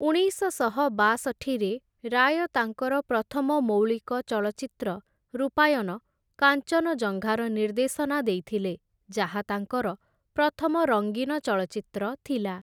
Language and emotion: Odia, neutral